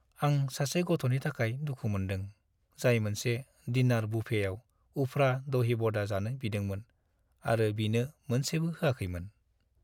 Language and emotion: Bodo, sad